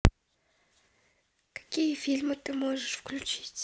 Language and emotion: Russian, neutral